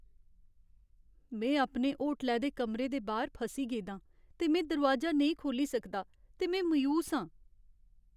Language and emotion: Dogri, sad